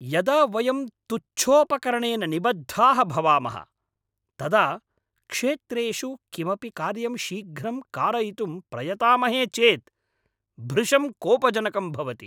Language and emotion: Sanskrit, angry